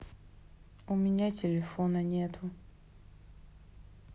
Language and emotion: Russian, sad